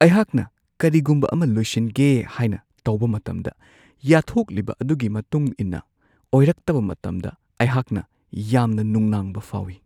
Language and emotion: Manipuri, fearful